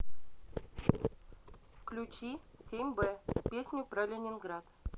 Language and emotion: Russian, neutral